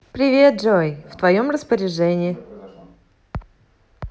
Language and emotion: Russian, positive